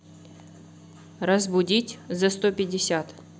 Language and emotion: Russian, neutral